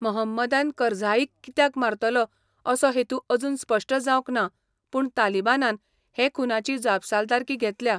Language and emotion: Goan Konkani, neutral